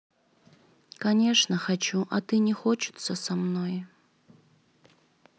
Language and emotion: Russian, sad